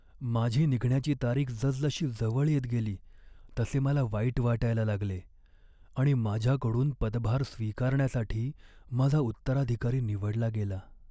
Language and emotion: Marathi, sad